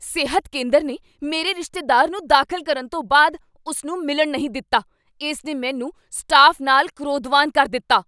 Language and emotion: Punjabi, angry